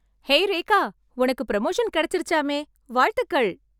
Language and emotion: Tamil, happy